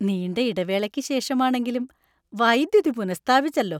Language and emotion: Malayalam, happy